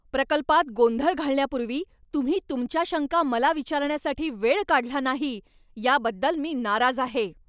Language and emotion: Marathi, angry